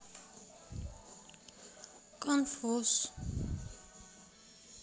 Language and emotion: Russian, sad